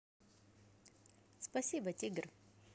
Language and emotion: Russian, positive